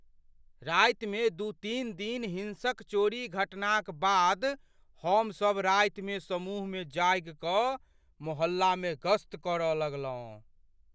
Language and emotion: Maithili, fearful